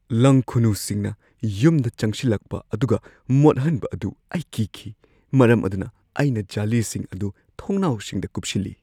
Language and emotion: Manipuri, fearful